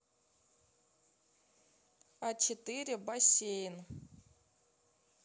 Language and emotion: Russian, neutral